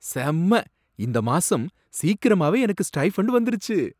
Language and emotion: Tamil, surprised